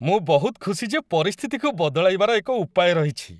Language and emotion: Odia, happy